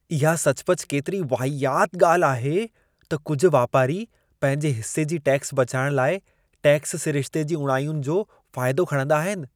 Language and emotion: Sindhi, disgusted